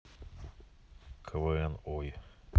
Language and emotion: Russian, neutral